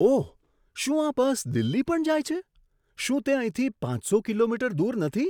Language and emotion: Gujarati, surprised